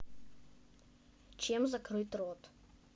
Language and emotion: Russian, neutral